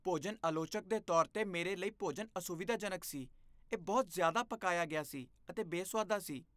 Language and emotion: Punjabi, disgusted